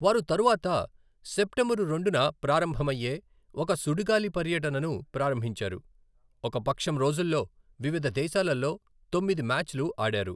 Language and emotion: Telugu, neutral